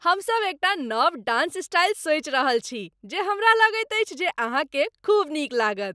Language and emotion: Maithili, happy